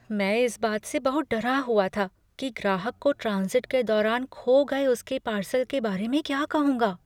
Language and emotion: Hindi, fearful